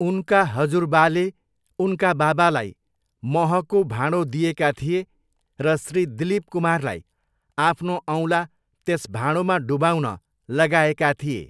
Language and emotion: Nepali, neutral